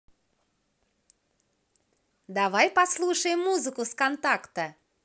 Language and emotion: Russian, positive